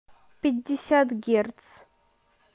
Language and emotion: Russian, neutral